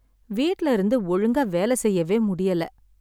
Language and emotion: Tamil, sad